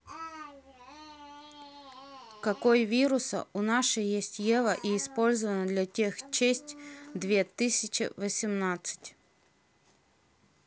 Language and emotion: Russian, neutral